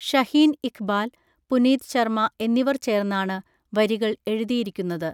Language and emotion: Malayalam, neutral